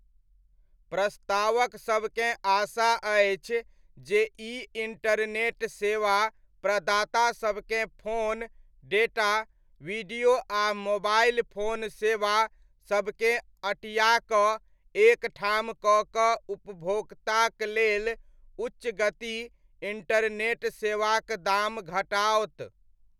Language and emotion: Maithili, neutral